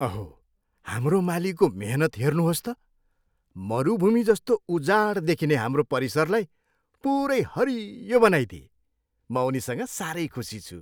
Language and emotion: Nepali, happy